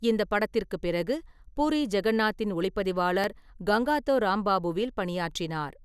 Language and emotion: Tamil, neutral